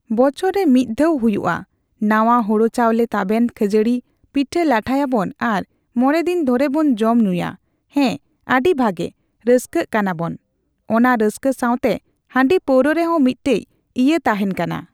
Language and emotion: Santali, neutral